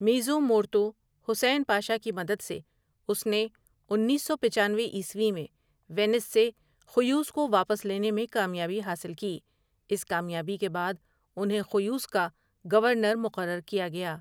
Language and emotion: Urdu, neutral